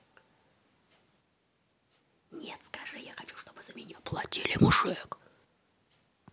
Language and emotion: Russian, angry